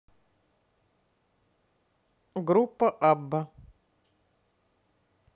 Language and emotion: Russian, neutral